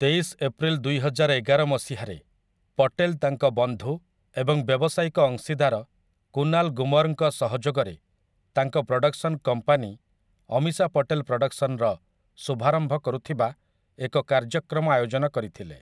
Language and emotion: Odia, neutral